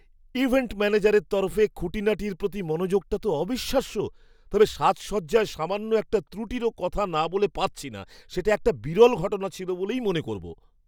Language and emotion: Bengali, surprised